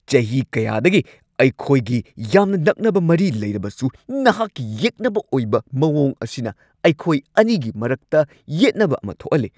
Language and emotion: Manipuri, angry